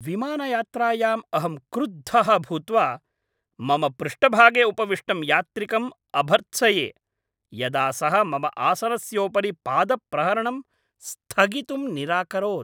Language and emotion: Sanskrit, angry